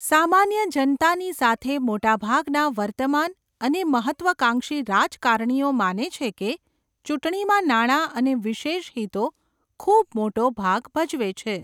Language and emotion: Gujarati, neutral